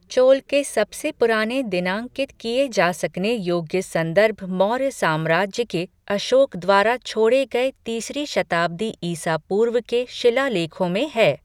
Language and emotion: Hindi, neutral